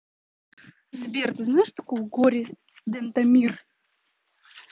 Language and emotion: Russian, neutral